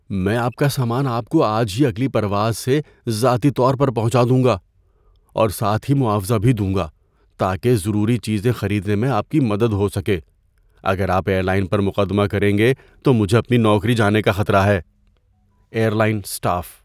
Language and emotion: Urdu, fearful